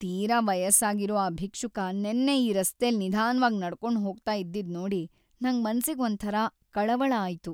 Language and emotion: Kannada, sad